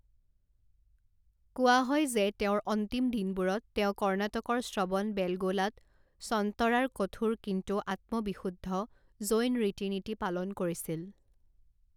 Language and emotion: Assamese, neutral